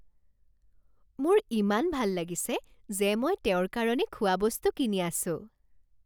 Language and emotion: Assamese, happy